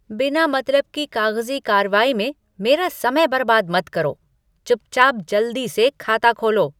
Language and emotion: Hindi, angry